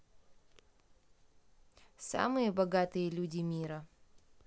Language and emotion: Russian, neutral